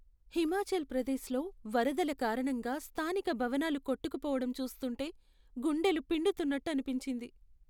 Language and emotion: Telugu, sad